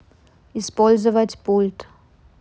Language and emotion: Russian, neutral